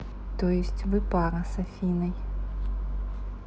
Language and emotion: Russian, neutral